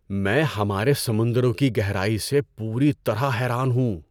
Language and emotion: Urdu, surprised